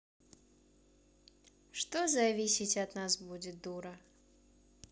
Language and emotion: Russian, neutral